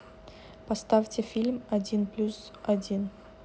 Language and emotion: Russian, neutral